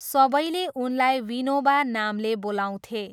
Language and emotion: Nepali, neutral